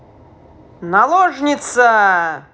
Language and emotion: Russian, positive